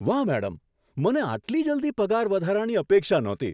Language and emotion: Gujarati, surprised